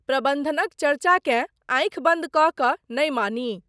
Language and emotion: Maithili, neutral